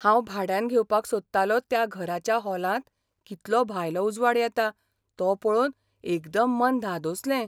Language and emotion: Goan Konkani, surprised